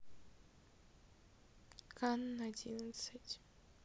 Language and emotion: Russian, sad